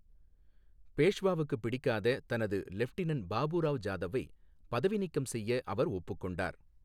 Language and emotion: Tamil, neutral